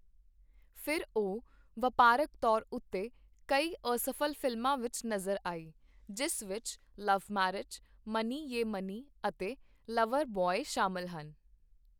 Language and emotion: Punjabi, neutral